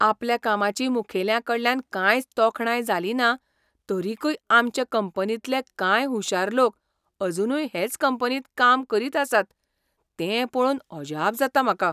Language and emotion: Goan Konkani, surprised